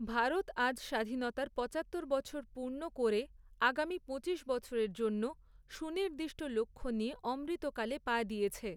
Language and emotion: Bengali, neutral